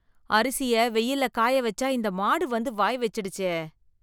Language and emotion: Tamil, disgusted